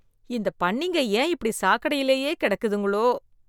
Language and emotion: Tamil, disgusted